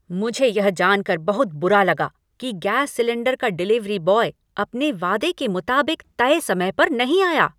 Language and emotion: Hindi, angry